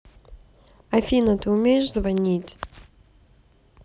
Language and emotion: Russian, neutral